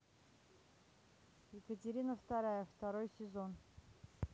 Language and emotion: Russian, neutral